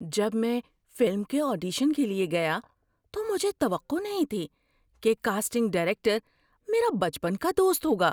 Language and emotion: Urdu, surprised